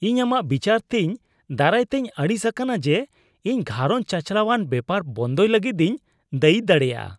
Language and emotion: Santali, disgusted